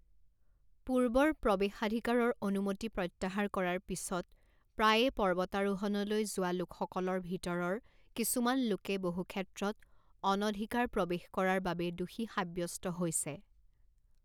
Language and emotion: Assamese, neutral